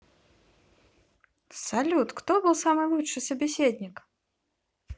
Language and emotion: Russian, positive